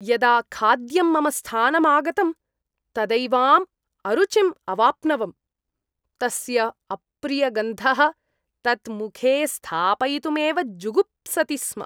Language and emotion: Sanskrit, disgusted